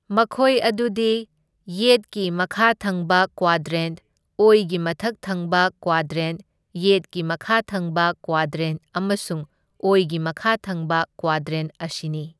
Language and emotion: Manipuri, neutral